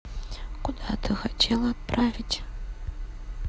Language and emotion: Russian, neutral